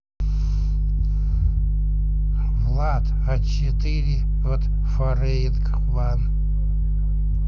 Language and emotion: Russian, neutral